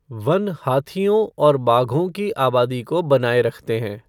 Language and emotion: Hindi, neutral